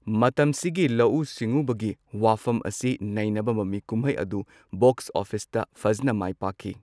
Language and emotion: Manipuri, neutral